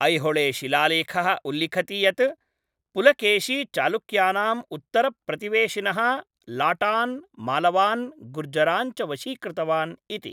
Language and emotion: Sanskrit, neutral